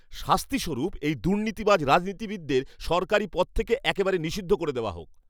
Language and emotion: Bengali, angry